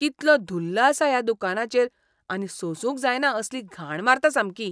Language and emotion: Goan Konkani, disgusted